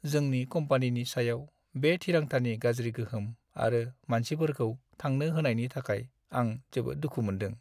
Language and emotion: Bodo, sad